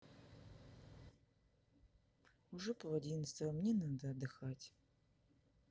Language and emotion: Russian, sad